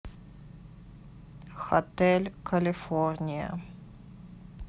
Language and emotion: Russian, neutral